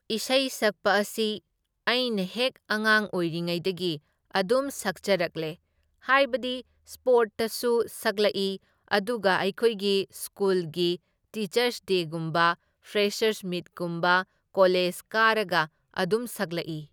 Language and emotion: Manipuri, neutral